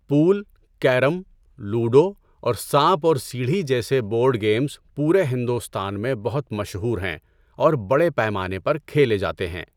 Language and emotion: Urdu, neutral